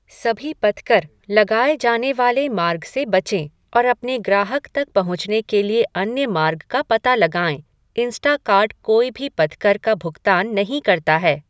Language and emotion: Hindi, neutral